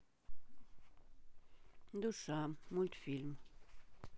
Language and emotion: Russian, neutral